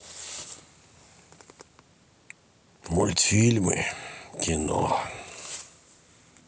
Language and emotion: Russian, sad